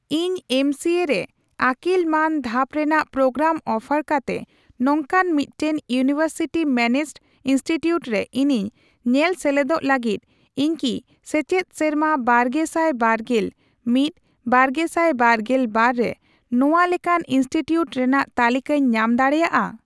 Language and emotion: Santali, neutral